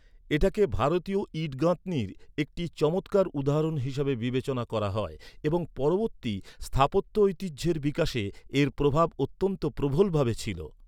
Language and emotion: Bengali, neutral